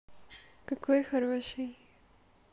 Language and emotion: Russian, positive